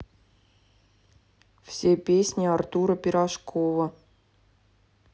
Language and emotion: Russian, neutral